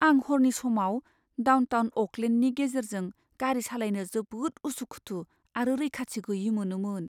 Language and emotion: Bodo, fearful